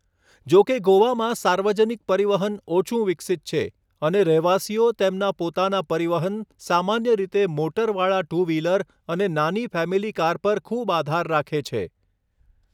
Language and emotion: Gujarati, neutral